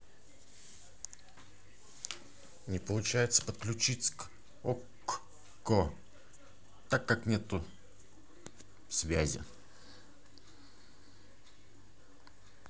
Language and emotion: Russian, angry